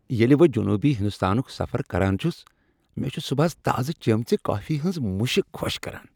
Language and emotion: Kashmiri, happy